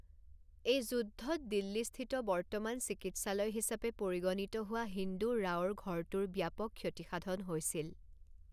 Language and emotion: Assamese, neutral